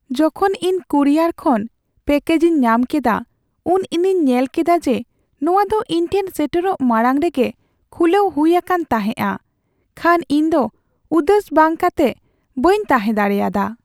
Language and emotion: Santali, sad